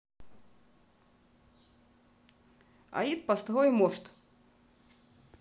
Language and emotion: Russian, neutral